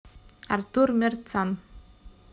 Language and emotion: Russian, neutral